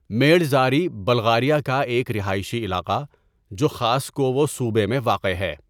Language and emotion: Urdu, neutral